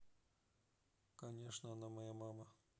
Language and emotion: Russian, neutral